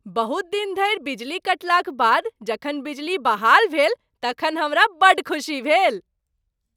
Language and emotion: Maithili, happy